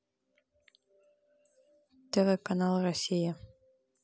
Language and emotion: Russian, neutral